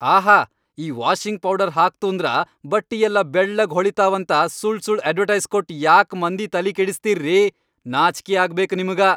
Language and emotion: Kannada, angry